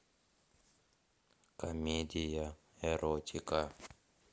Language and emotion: Russian, neutral